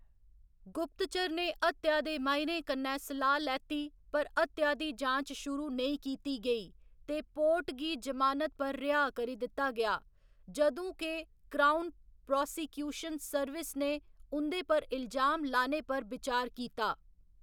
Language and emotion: Dogri, neutral